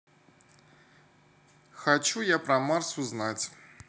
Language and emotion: Russian, positive